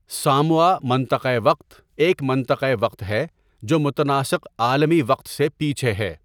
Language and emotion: Urdu, neutral